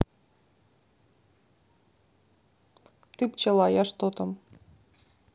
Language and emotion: Russian, neutral